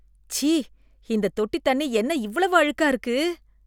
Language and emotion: Tamil, disgusted